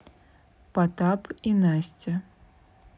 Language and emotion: Russian, neutral